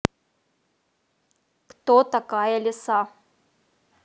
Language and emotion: Russian, angry